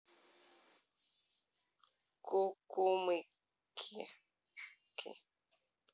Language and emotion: Russian, neutral